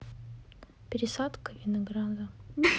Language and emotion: Russian, sad